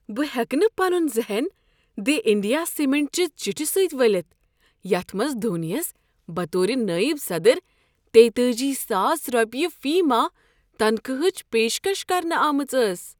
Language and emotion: Kashmiri, surprised